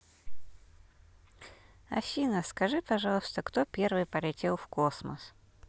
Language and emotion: Russian, neutral